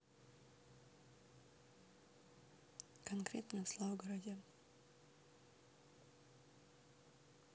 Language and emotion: Russian, neutral